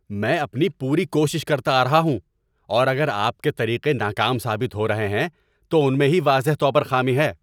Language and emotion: Urdu, angry